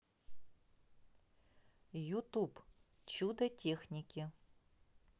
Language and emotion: Russian, neutral